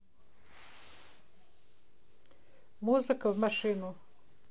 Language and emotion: Russian, neutral